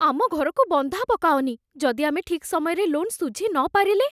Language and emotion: Odia, fearful